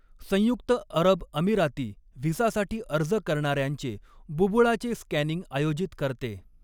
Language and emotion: Marathi, neutral